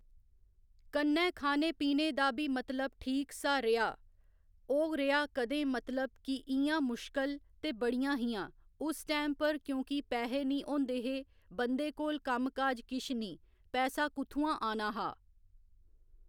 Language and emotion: Dogri, neutral